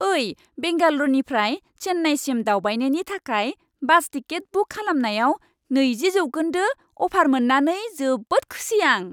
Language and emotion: Bodo, happy